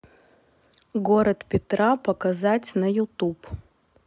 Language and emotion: Russian, neutral